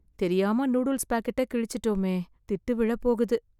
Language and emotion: Tamil, fearful